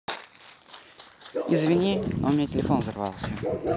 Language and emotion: Russian, neutral